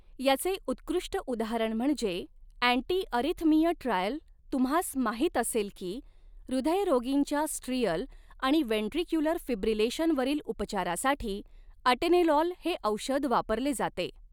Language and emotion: Marathi, neutral